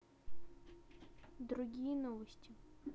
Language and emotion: Russian, neutral